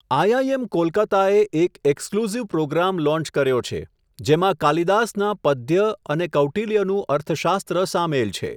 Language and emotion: Gujarati, neutral